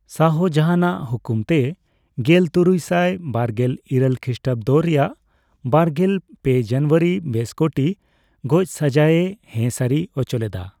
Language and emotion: Santali, neutral